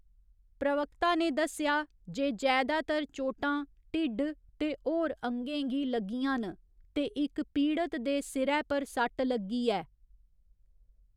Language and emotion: Dogri, neutral